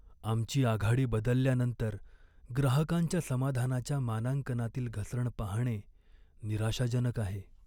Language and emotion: Marathi, sad